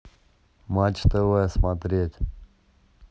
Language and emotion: Russian, neutral